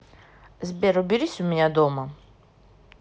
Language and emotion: Russian, neutral